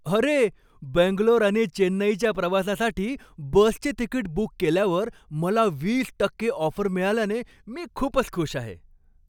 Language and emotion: Marathi, happy